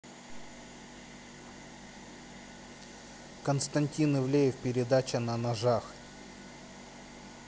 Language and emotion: Russian, neutral